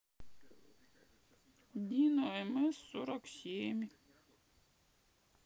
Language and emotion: Russian, sad